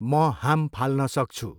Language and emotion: Nepali, neutral